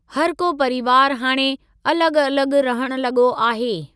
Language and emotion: Sindhi, neutral